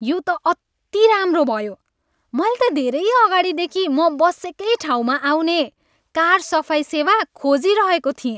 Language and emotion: Nepali, happy